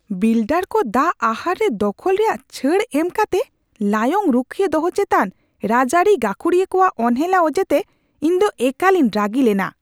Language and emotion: Santali, angry